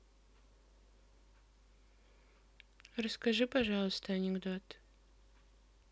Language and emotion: Russian, neutral